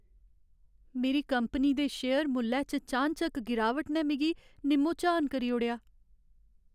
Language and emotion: Dogri, sad